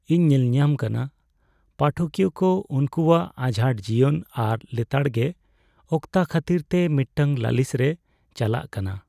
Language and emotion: Santali, sad